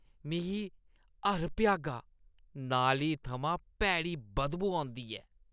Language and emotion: Dogri, disgusted